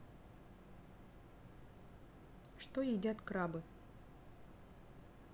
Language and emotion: Russian, neutral